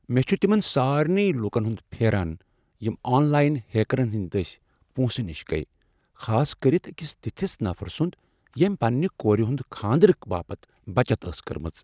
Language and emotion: Kashmiri, sad